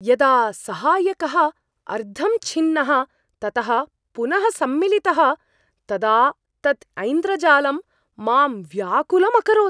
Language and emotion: Sanskrit, surprised